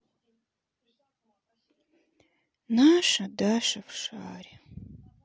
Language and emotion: Russian, sad